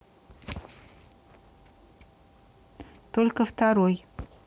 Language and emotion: Russian, neutral